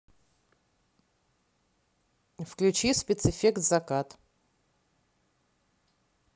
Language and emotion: Russian, neutral